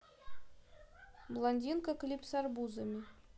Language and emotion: Russian, neutral